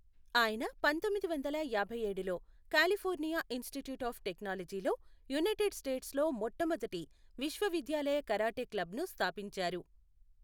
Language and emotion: Telugu, neutral